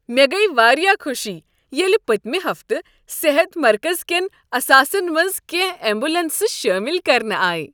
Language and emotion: Kashmiri, happy